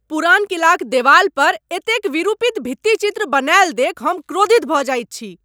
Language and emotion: Maithili, angry